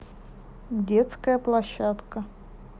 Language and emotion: Russian, neutral